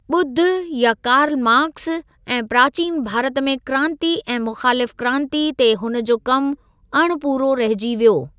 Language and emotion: Sindhi, neutral